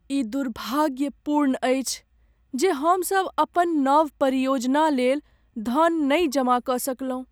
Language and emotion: Maithili, sad